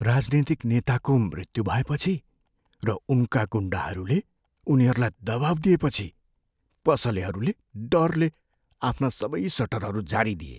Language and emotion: Nepali, fearful